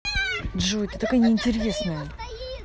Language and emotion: Russian, angry